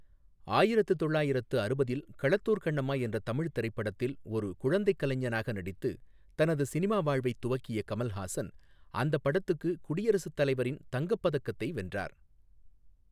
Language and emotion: Tamil, neutral